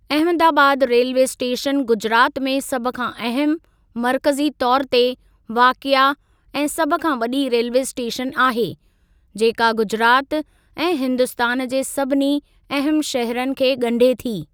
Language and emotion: Sindhi, neutral